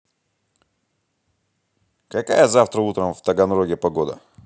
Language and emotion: Russian, positive